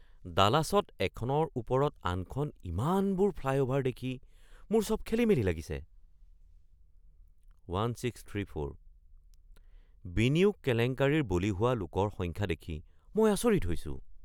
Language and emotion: Assamese, surprised